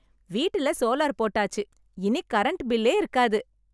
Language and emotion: Tamil, happy